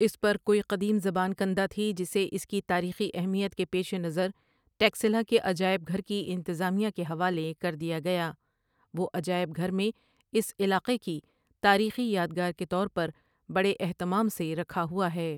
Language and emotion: Urdu, neutral